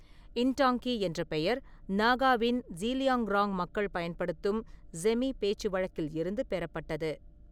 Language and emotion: Tamil, neutral